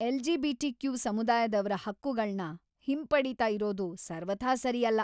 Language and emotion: Kannada, angry